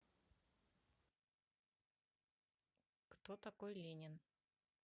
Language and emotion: Russian, neutral